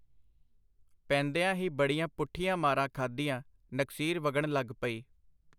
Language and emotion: Punjabi, neutral